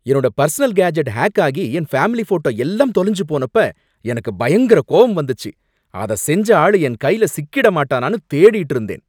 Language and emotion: Tamil, angry